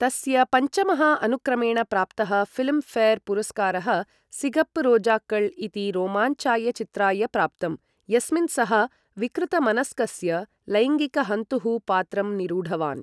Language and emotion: Sanskrit, neutral